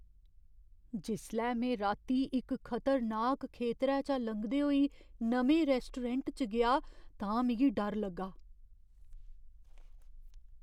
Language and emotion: Dogri, fearful